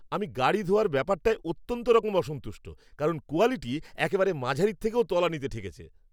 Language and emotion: Bengali, angry